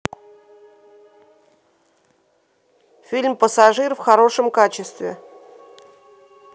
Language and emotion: Russian, neutral